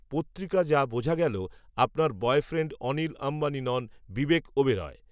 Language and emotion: Bengali, neutral